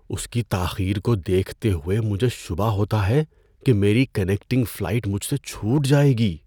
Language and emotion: Urdu, fearful